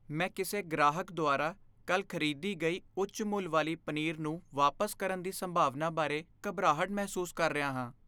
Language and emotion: Punjabi, fearful